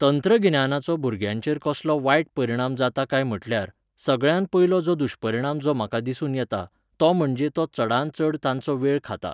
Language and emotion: Goan Konkani, neutral